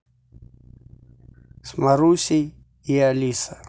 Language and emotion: Russian, neutral